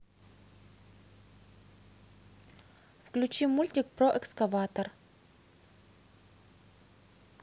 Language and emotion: Russian, neutral